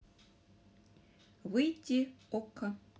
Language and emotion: Russian, neutral